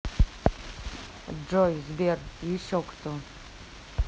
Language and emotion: Russian, neutral